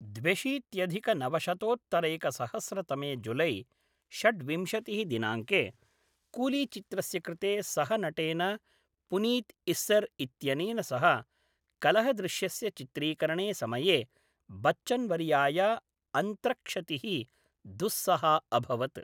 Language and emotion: Sanskrit, neutral